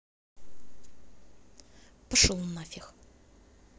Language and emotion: Russian, angry